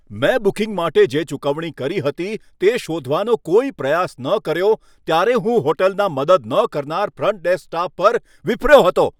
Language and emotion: Gujarati, angry